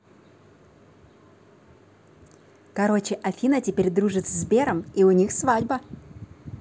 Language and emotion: Russian, positive